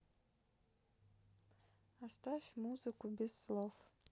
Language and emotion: Russian, sad